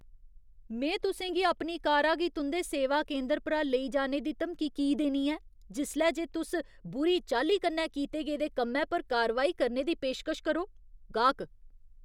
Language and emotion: Dogri, disgusted